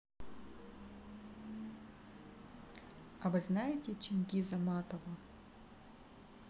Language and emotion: Russian, neutral